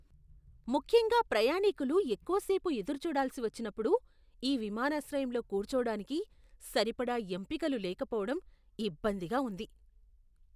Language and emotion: Telugu, disgusted